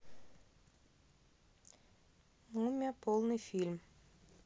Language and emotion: Russian, neutral